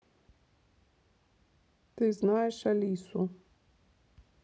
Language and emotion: Russian, neutral